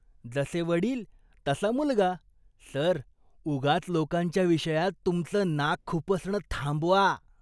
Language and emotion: Marathi, disgusted